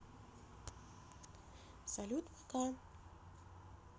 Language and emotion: Russian, neutral